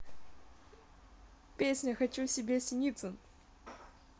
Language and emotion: Russian, neutral